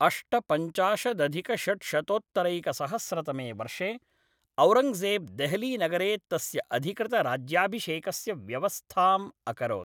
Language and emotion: Sanskrit, neutral